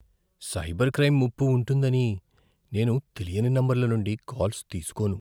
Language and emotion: Telugu, fearful